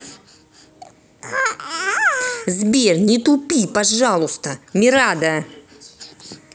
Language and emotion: Russian, angry